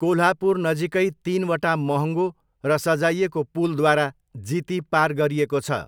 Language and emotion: Nepali, neutral